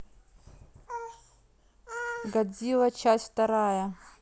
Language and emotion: Russian, neutral